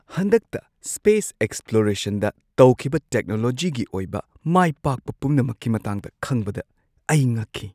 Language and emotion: Manipuri, surprised